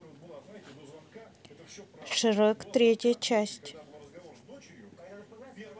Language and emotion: Russian, neutral